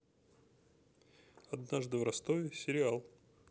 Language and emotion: Russian, neutral